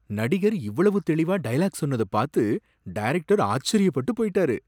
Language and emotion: Tamil, surprised